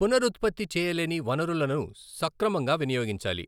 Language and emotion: Telugu, neutral